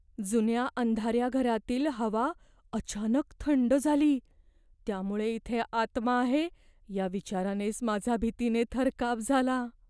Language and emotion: Marathi, fearful